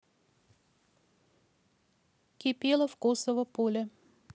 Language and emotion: Russian, neutral